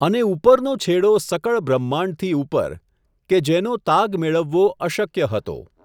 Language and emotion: Gujarati, neutral